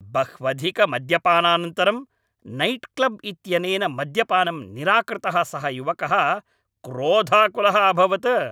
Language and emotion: Sanskrit, angry